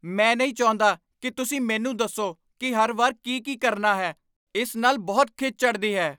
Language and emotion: Punjabi, angry